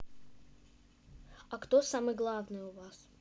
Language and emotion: Russian, neutral